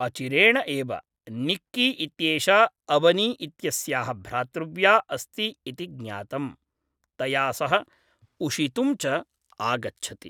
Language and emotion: Sanskrit, neutral